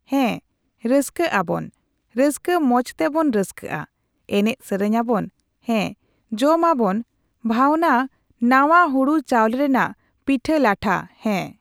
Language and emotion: Santali, neutral